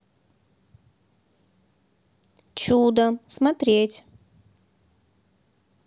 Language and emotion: Russian, neutral